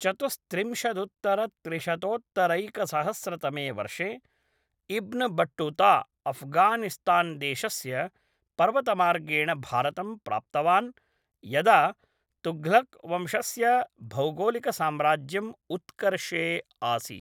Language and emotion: Sanskrit, neutral